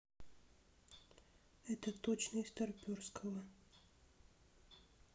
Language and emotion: Russian, neutral